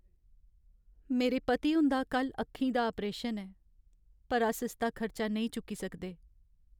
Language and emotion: Dogri, sad